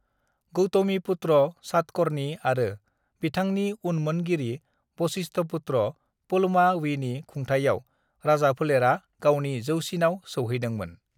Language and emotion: Bodo, neutral